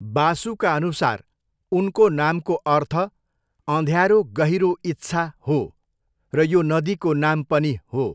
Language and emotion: Nepali, neutral